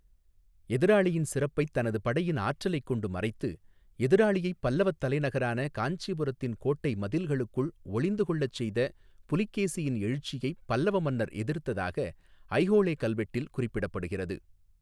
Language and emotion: Tamil, neutral